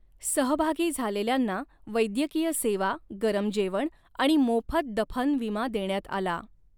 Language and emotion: Marathi, neutral